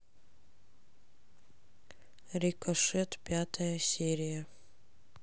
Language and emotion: Russian, neutral